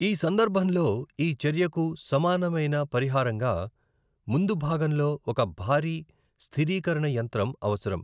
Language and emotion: Telugu, neutral